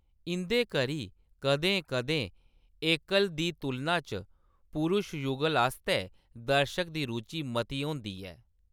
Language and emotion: Dogri, neutral